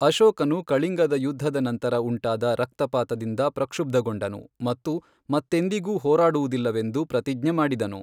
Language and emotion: Kannada, neutral